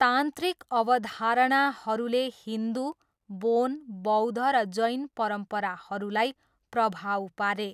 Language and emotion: Nepali, neutral